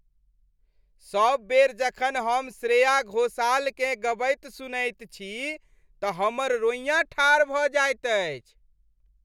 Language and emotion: Maithili, happy